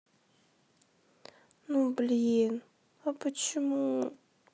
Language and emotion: Russian, sad